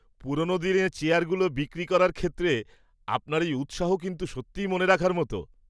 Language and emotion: Bengali, surprised